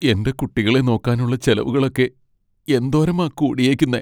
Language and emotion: Malayalam, sad